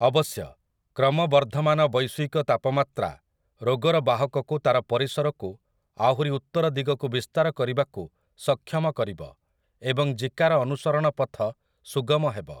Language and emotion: Odia, neutral